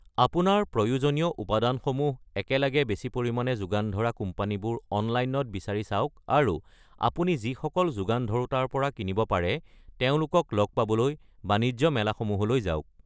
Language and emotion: Assamese, neutral